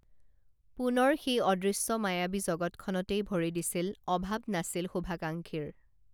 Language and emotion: Assamese, neutral